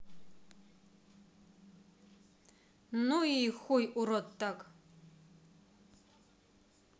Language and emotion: Russian, neutral